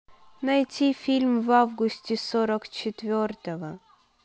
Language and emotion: Russian, neutral